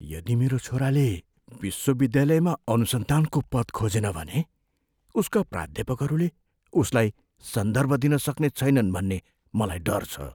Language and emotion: Nepali, fearful